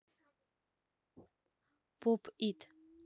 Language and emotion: Russian, neutral